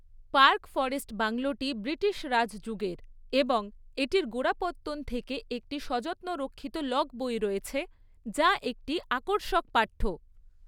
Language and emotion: Bengali, neutral